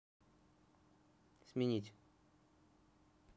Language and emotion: Russian, neutral